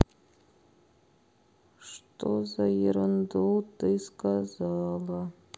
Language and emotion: Russian, sad